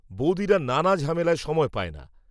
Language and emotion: Bengali, neutral